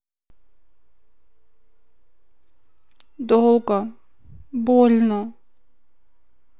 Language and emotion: Russian, sad